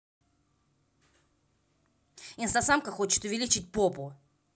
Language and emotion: Russian, angry